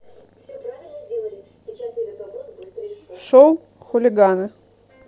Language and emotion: Russian, neutral